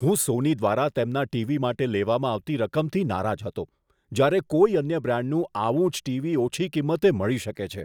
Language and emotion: Gujarati, disgusted